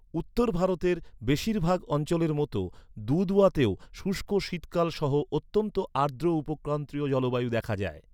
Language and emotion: Bengali, neutral